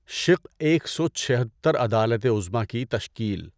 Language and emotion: Urdu, neutral